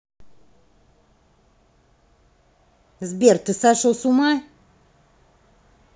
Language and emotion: Russian, angry